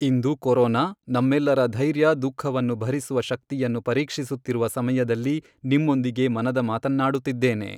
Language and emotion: Kannada, neutral